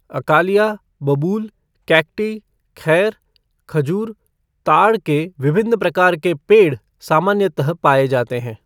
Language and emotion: Hindi, neutral